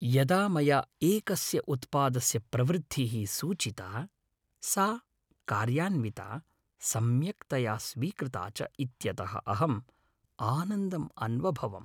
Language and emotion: Sanskrit, happy